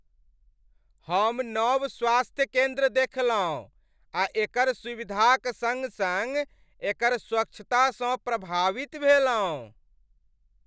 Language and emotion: Maithili, happy